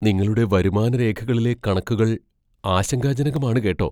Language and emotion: Malayalam, fearful